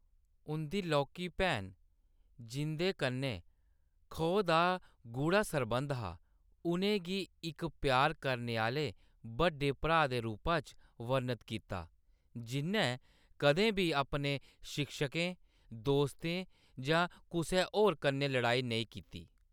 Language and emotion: Dogri, neutral